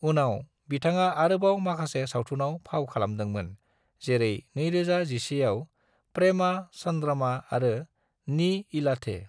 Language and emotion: Bodo, neutral